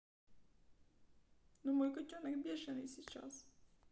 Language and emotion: Russian, sad